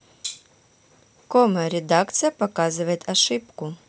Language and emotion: Russian, neutral